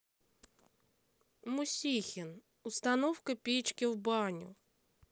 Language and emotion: Russian, sad